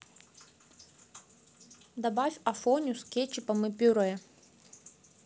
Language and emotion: Russian, neutral